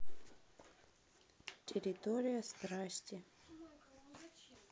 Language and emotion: Russian, neutral